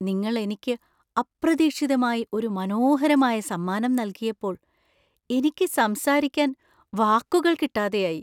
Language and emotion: Malayalam, surprised